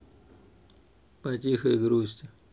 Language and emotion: Russian, neutral